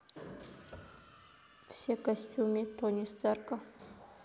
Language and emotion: Russian, neutral